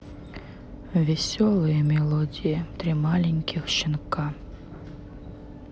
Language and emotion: Russian, sad